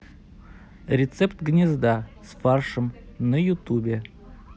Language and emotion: Russian, neutral